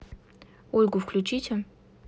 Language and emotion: Russian, neutral